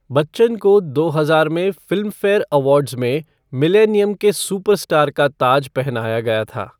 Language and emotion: Hindi, neutral